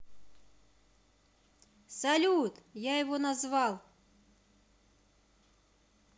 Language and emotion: Russian, positive